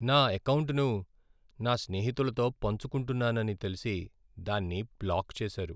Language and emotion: Telugu, sad